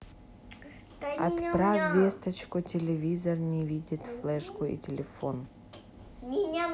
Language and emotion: Russian, neutral